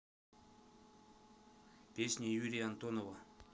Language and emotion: Russian, neutral